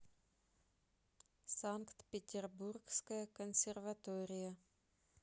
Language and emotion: Russian, neutral